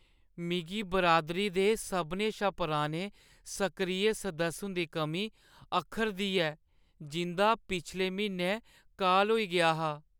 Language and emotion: Dogri, sad